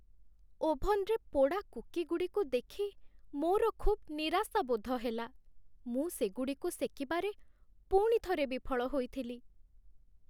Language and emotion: Odia, sad